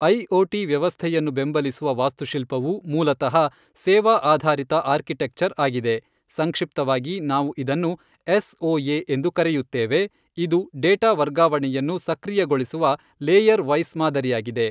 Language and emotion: Kannada, neutral